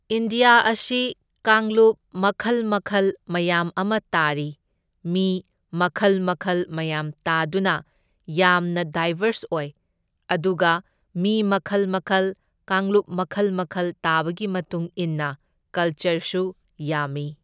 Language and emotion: Manipuri, neutral